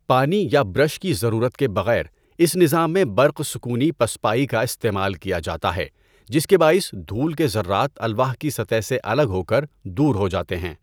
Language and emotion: Urdu, neutral